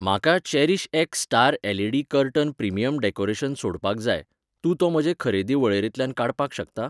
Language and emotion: Goan Konkani, neutral